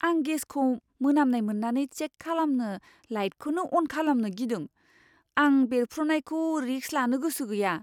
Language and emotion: Bodo, fearful